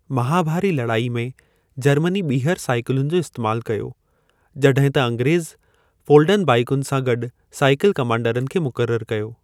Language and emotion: Sindhi, neutral